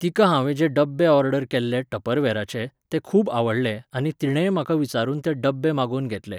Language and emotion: Goan Konkani, neutral